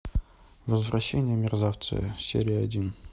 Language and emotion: Russian, neutral